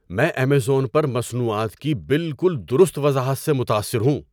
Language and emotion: Urdu, surprised